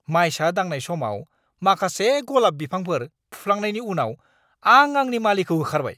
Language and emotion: Bodo, angry